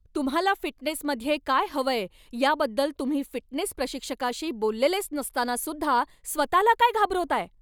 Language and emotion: Marathi, angry